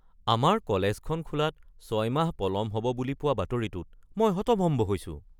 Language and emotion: Assamese, surprised